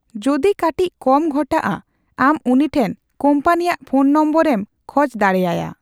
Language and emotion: Santali, neutral